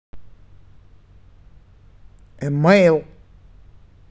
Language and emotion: Russian, neutral